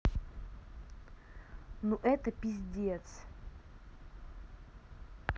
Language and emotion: Russian, angry